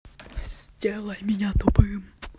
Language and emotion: Russian, neutral